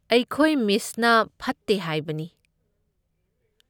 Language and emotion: Manipuri, neutral